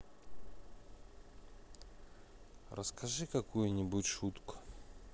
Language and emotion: Russian, neutral